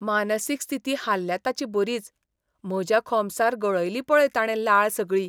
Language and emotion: Goan Konkani, disgusted